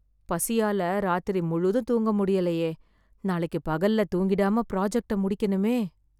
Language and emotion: Tamil, fearful